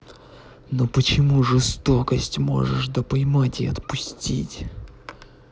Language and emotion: Russian, angry